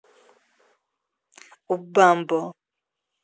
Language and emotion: Russian, neutral